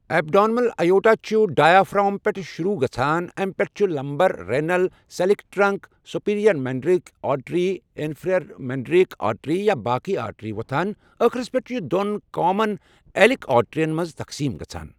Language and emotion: Kashmiri, neutral